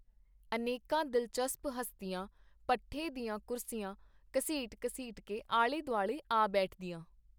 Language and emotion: Punjabi, neutral